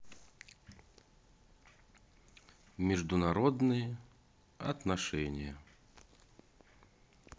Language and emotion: Russian, neutral